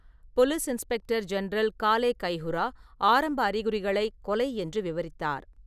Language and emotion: Tamil, neutral